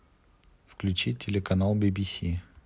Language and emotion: Russian, neutral